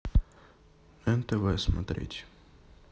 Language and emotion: Russian, neutral